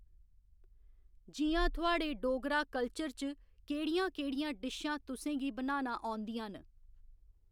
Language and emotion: Dogri, neutral